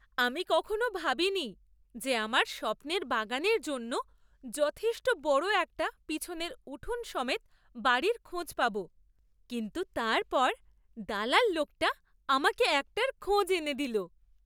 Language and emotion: Bengali, surprised